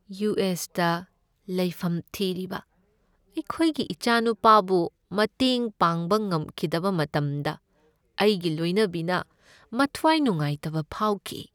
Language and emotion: Manipuri, sad